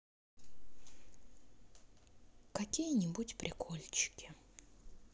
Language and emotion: Russian, sad